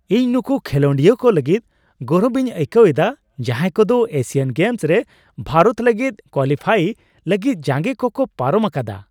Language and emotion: Santali, happy